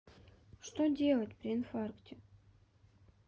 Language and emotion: Russian, sad